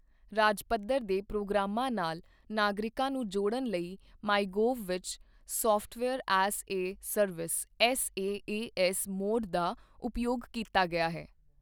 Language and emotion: Punjabi, neutral